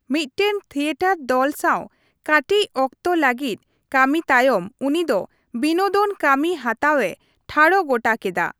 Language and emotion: Santali, neutral